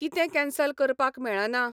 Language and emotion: Goan Konkani, neutral